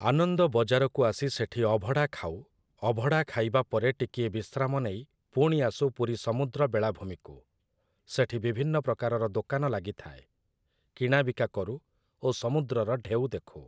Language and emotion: Odia, neutral